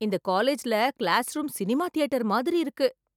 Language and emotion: Tamil, surprised